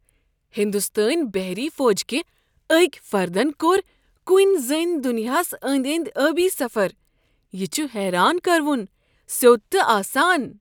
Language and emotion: Kashmiri, surprised